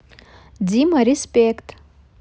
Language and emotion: Russian, positive